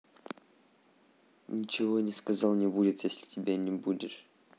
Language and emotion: Russian, neutral